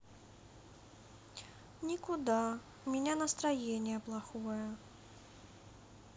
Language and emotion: Russian, sad